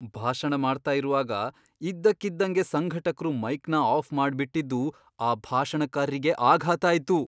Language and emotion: Kannada, surprised